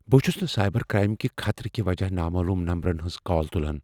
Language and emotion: Kashmiri, fearful